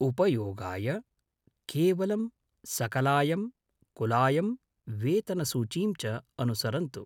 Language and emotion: Sanskrit, neutral